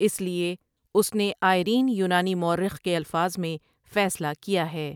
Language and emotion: Urdu, neutral